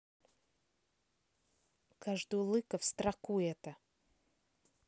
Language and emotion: Russian, angry